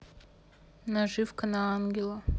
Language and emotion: Russian, neutral